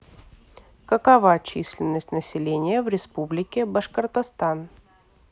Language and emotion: Russian, neutral